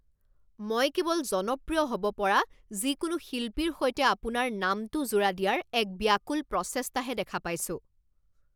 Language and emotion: Assamese, angry